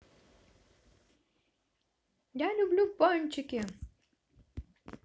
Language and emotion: Russian, positive